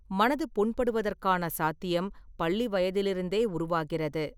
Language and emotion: Tamil, neutral